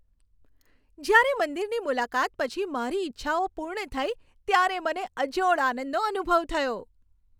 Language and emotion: Gujarati, happy